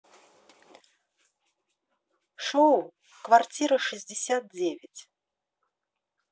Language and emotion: Russian, positive